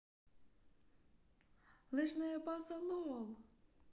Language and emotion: Russian, neutral